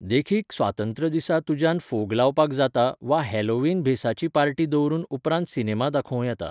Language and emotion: Goan Konkani, neutral